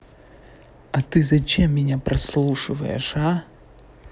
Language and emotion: Russian, angry